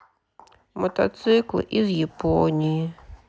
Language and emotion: Russian, sad